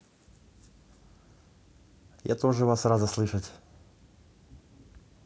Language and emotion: Russian, neutral